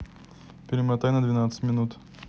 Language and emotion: Russian, neutral